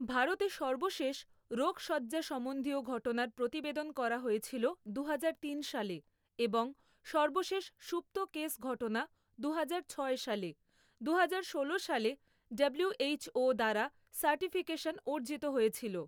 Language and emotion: Bengali, neutral